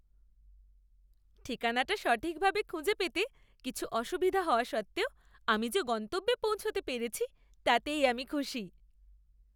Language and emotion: Bengali, happy